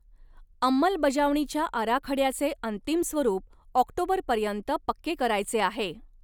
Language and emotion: Marathi, neutral